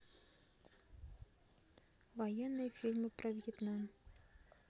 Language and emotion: Russian, neutral